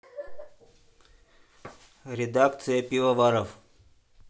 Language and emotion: Russian, neutral